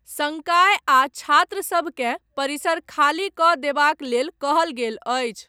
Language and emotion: Maithili, neutral